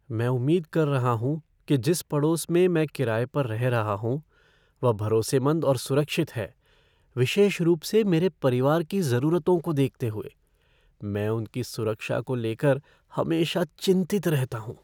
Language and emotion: Hindi, fearful